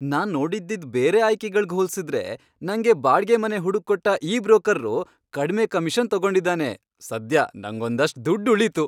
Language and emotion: Kannada, happy